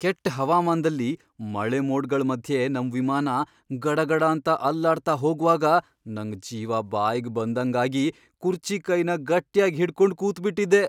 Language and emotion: Kannada, fearful